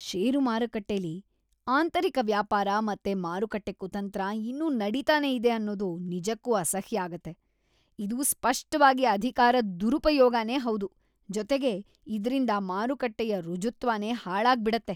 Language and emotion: Kannada, disgusted